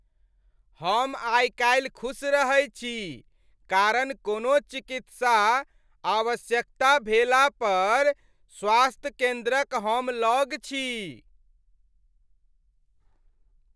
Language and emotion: Maithili, happy